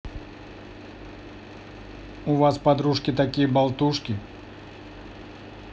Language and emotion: Russian, neutral